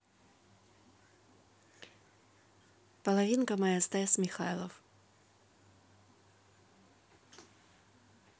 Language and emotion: Russian, neutral